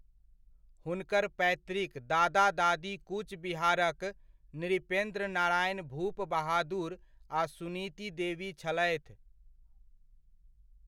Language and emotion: Maithili, neutral